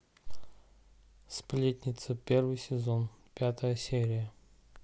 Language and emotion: Russian, neutral